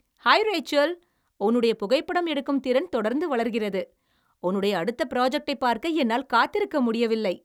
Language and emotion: Tamil, happy